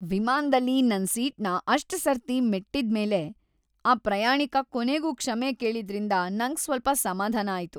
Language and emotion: Kannada, happy